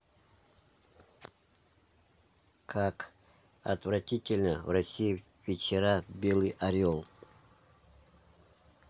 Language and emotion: Russian, neutral